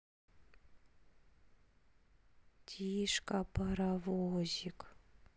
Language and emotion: Russian, sad